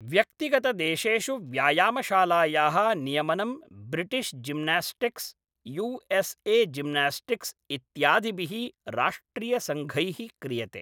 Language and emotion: Sanskrit, neutral